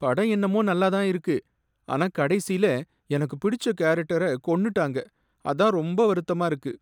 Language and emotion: Tamil, sad